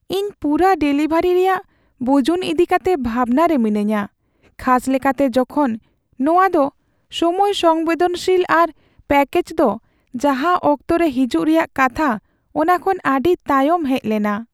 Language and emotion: Santali, sad